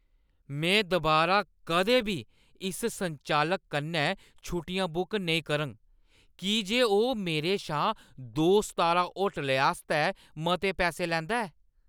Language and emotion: Dogri, angry